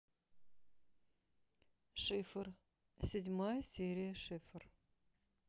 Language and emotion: Russian, neutral